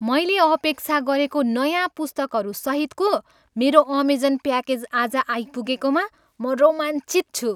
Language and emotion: Nepali, happy